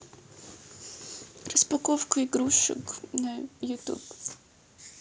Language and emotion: Russian, sad